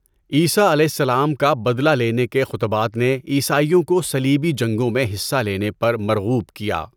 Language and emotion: Urdu, neutral